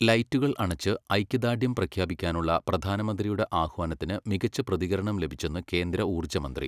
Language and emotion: Malayalam, neutral